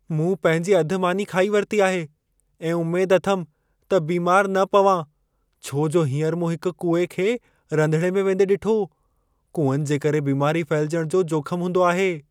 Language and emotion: Sindhi, fearful